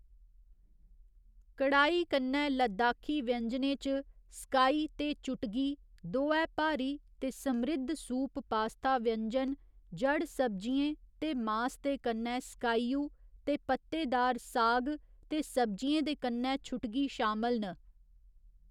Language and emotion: Dogri, neutral